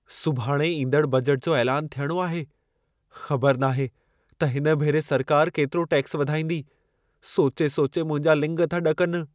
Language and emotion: Sindhi, fearful